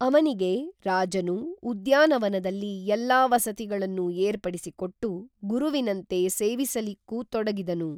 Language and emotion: Kannada, neutral